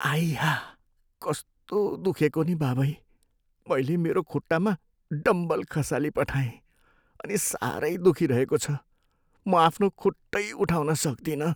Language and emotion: Nepali, sad